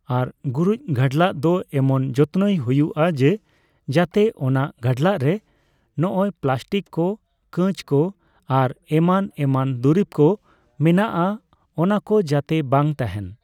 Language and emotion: Santali, neutral